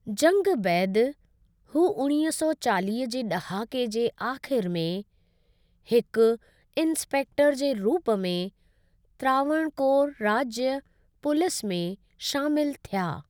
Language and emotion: Sindhi, neutral